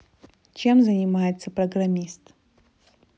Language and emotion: Russian, neutral